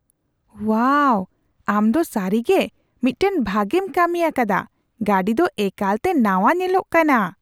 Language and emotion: Santali, surprised